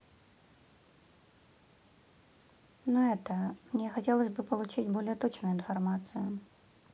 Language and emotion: Russian, neutral